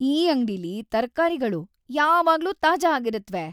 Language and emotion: Kannada, happy